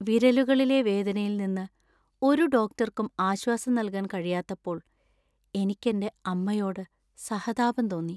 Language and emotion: Malayalam, sad